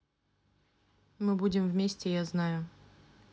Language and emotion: Russian, neutral